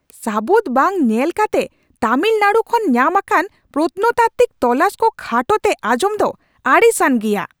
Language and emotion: Santali, angry